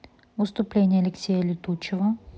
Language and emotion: Russian, neutral